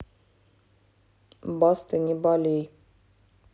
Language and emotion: Russian, neutral